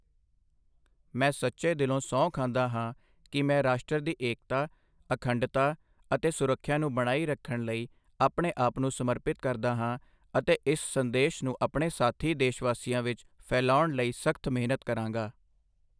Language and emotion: Punjabi, neutral